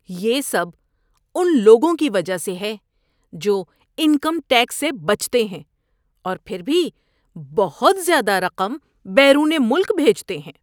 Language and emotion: Urdu, disgusted